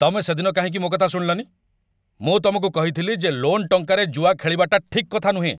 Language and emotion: Odia, angry